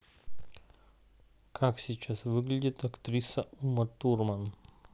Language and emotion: Russian, neutral